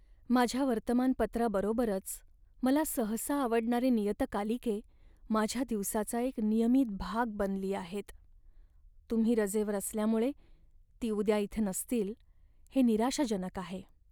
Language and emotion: Marathi, sad